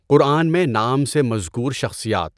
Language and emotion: Urdu, neutral